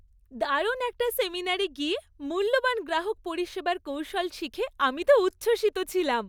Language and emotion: Bengali, happy